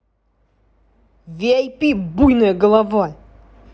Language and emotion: Russian, angry